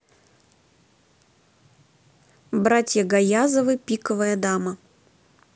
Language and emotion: Russian, neutral